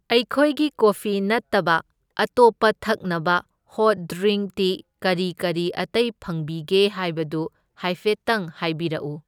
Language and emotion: Manipuri, neutral